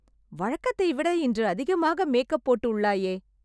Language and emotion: Tamil, surprised